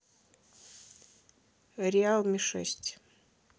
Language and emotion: Russian, neutral